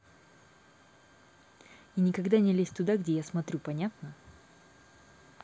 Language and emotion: Russian, angry